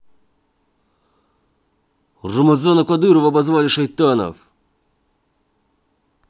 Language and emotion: Russian, angry